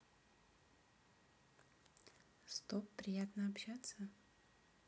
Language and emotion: Russian, neutral